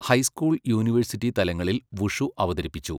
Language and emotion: Malayalam, neutral